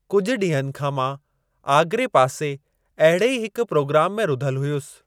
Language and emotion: Sindhi, neutral